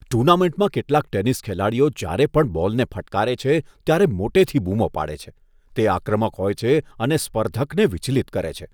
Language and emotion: Gujarati, disgusted